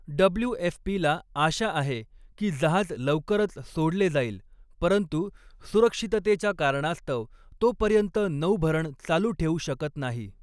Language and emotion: Marathi, neutral